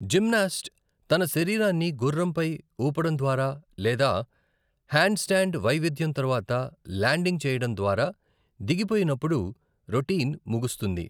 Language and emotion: Telugu, neutral